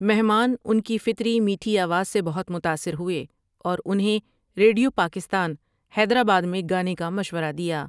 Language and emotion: Urdu, neutral